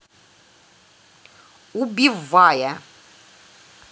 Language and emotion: Russian, angry